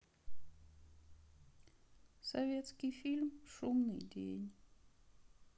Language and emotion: Russian, sad